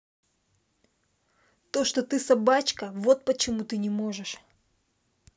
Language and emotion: Russian, angry